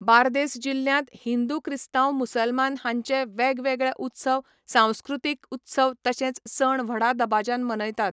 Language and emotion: Goan Konkani, neutral